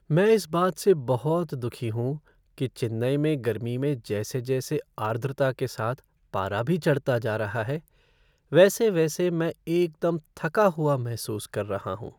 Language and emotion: Hindi, sad